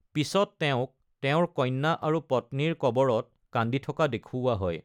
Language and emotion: Assamese, neutral